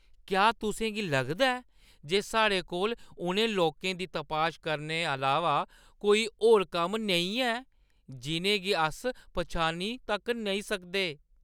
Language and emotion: Dogri, disgusted